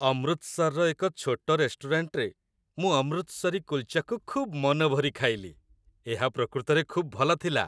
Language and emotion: Odia, happy